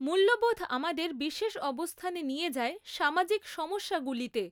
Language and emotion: Bengali, neutral